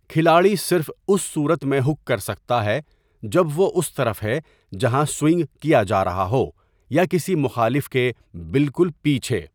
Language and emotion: Urdu, neutral